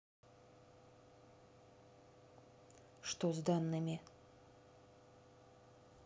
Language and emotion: Russian, neutral